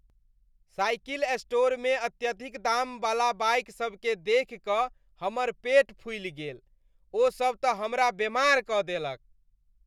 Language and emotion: Maithili, disgusted